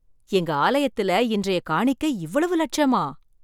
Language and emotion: Tamil, surprised